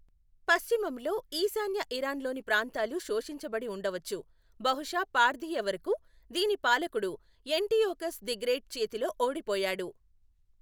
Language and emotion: Telugu, neutral